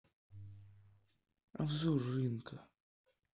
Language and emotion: Russian, sad